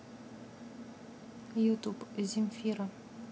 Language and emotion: Russian, neutral